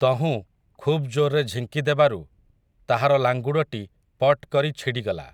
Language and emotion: Odia, neutral